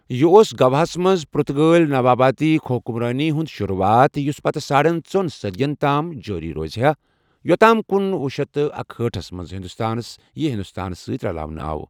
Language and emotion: Kashmiri, neutral